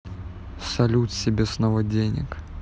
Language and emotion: Russian, neutral